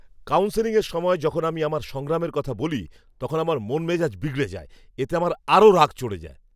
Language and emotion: Bengali, angry